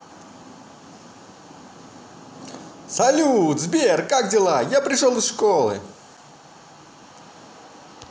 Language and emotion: Russian, positive